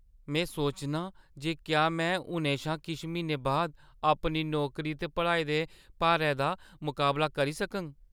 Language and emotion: Dogri, fearful